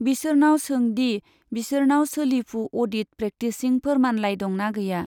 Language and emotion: Bodo, neutral